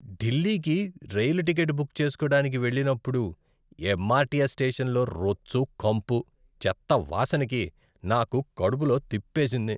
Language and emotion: Telugu, disgusted